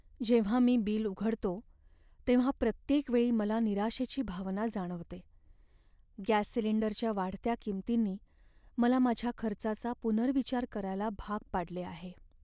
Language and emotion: Marathi, sad